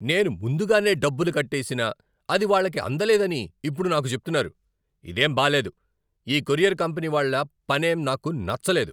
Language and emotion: Telugu, angry